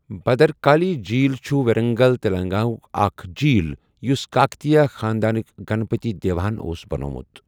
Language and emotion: Kashmiri, neutral